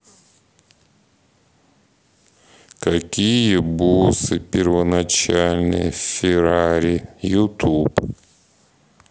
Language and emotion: Russian, neutral